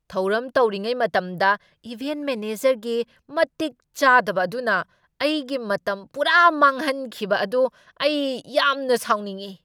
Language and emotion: Manipuri, angry